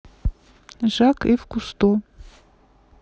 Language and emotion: Russian, neutral